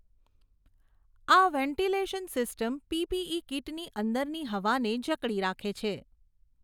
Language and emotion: Gujarati, neutral